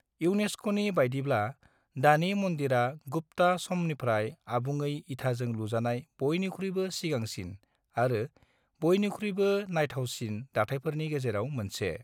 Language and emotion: Bodo, neutral